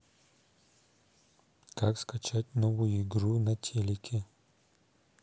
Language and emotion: Russian, neutral